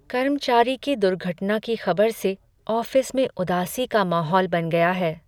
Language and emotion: Hindi, sad